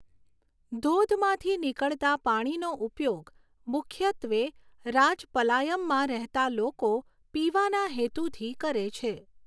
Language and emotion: Gujarati, neutral